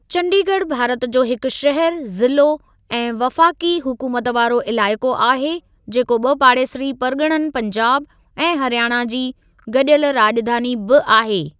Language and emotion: Sindhi, neutral